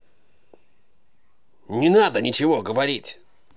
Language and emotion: Russian, angry